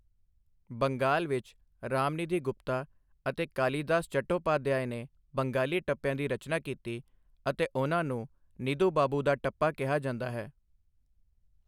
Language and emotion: Punjabi, neutral